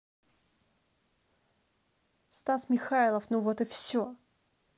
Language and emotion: Russian, angry